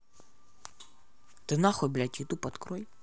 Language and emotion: Russian, angry